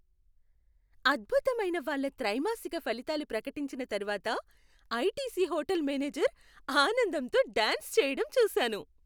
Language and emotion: Telugu, happy